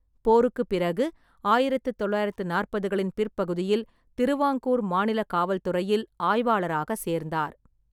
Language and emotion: Tamil, neutral